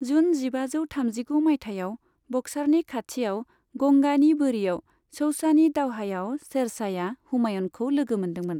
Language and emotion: Bodo, neutral